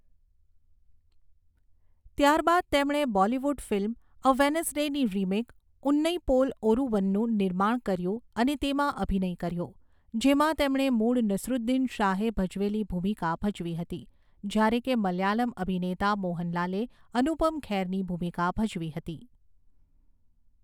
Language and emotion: Gujarati, neutral